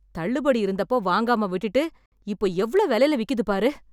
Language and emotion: Tamil, angry